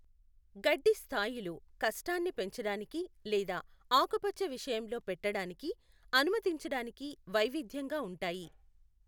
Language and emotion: Telugu, neutral